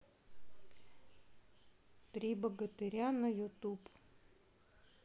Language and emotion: Russian, neutral